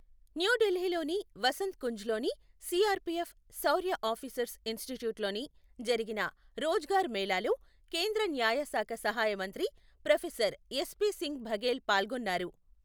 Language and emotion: Telugu, neutral